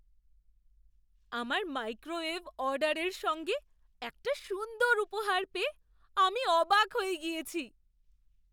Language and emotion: Bengali, surprised